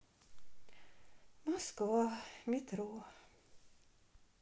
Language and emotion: Russian, sad